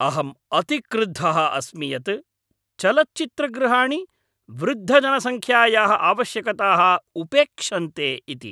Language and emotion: Sanskrit, angry